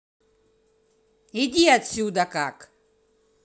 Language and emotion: Russian, angry